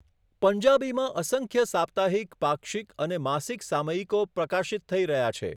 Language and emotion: Gujarati, neutral